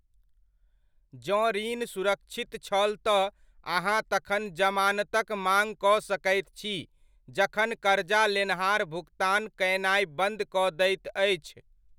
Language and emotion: Maithili, neutral